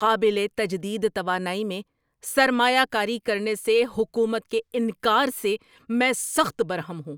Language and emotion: Urdu, angry